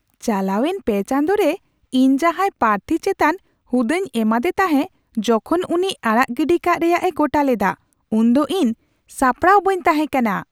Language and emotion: Santali, surprised